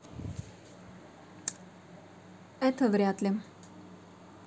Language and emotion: Russian, neutral